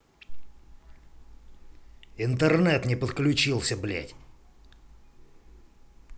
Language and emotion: Russian, angry